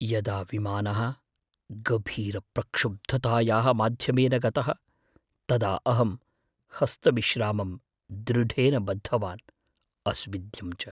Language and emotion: Sanskrit, fearful